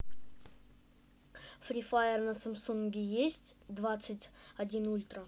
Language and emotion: Russian, neutral